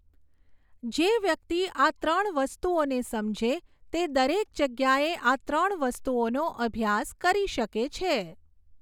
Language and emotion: Gujarati, neutral